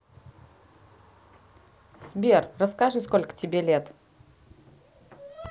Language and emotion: Russian, positive